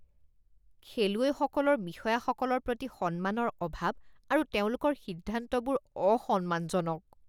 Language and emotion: Assamese, disgusted